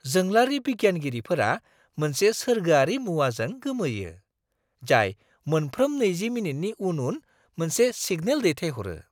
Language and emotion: Bodo, surprised